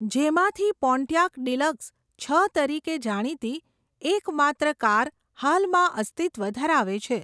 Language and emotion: Gujarati, neutral